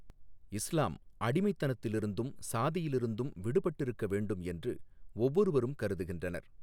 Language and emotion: Tamil, neutral